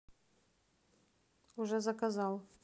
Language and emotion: Russian, neutral